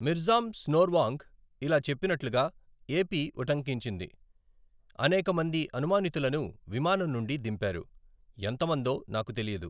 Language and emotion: Telugu, neutral